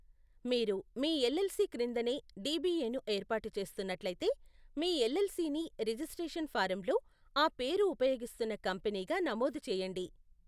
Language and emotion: Telugu, neutral